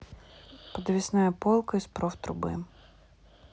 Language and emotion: Russian, neutral